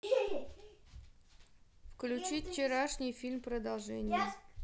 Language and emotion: Russian, neutral